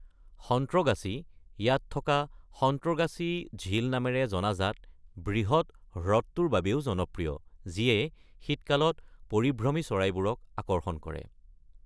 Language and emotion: Assamese, neutral